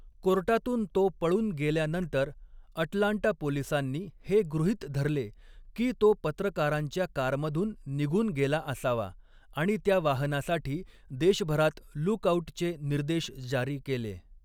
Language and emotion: Marathi, neutral